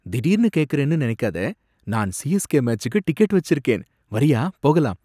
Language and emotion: Tamil, surprised